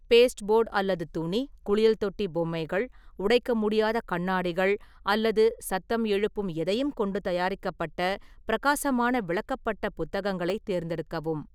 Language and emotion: Tamil, neutral